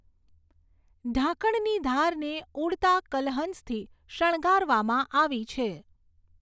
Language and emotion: Gujarati, neutral